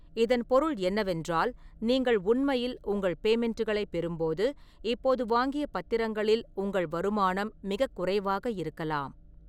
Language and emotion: Tamil, neutral